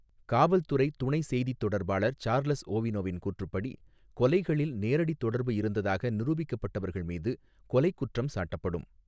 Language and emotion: Tamil, neutral